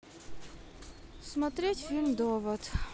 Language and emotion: Russian, sad